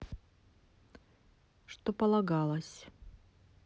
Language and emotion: Russian, neutral